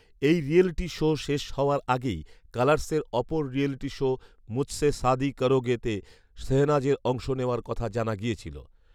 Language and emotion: Bengali, neutral